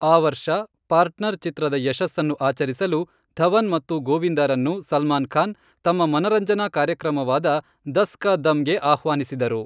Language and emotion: Kannada, neutral